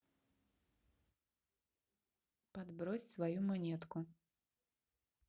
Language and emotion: Russian, neutral